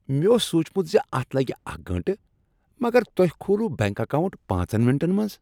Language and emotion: Kashmiri, happy